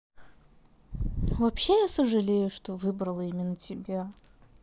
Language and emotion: Russian, neutral